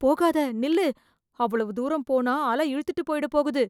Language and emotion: Tamil, fearful